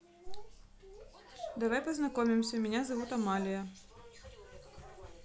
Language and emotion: Russian, neutral